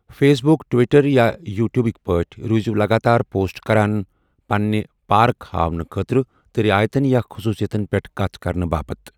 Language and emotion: Kashmiri, neutral